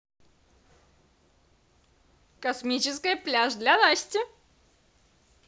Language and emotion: Russian, positive